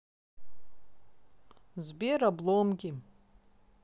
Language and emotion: Russian, neutral